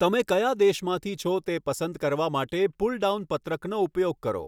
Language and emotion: Gujarati, neutral